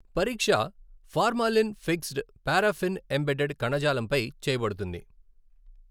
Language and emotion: Telugu, neutral